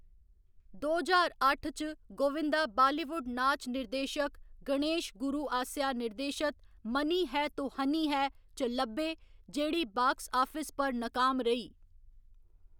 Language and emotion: Dogri, neutral